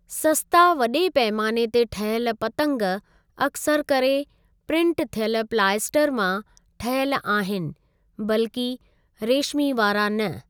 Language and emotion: Sindhi, neutral